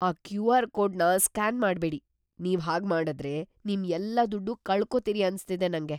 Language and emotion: Kannada, fearful